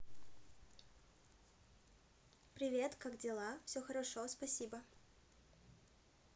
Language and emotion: Russian, positive